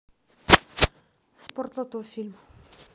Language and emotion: Russian, neutral